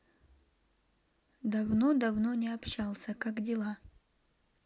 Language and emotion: Russian, neutral